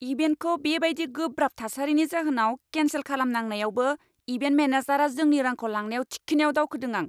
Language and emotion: Bodo, angry